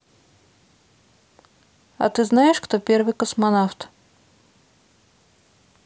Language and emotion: Russian, neutral